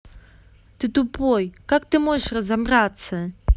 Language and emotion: Russian, angry